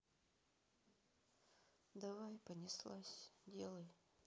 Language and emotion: Russian, sad